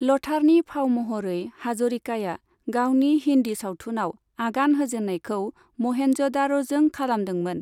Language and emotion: Bodo, neutral